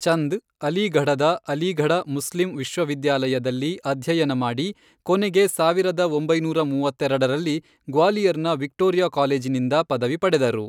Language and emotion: Kannada, neutral